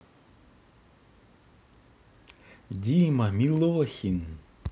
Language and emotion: Russian, positive